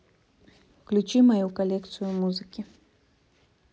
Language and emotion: Russian, neutral